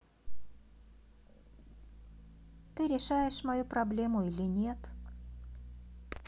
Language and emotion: Russian, neutral